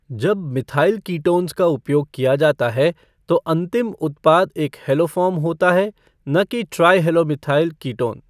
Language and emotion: Hindi, neutral